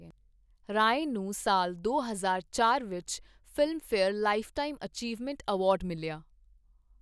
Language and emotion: Punjabi, neutral